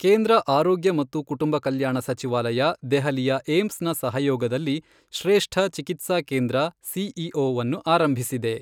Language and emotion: Kannada, neutral